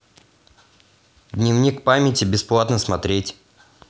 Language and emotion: Russian, neutral